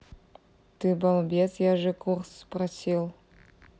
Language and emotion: Russian, neutral